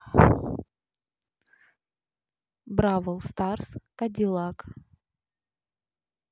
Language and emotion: Russian, neutral